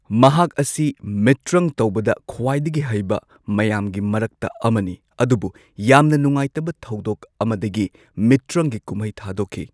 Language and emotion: Manipuri, neutral